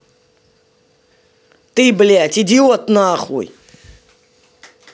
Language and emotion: Russian, angry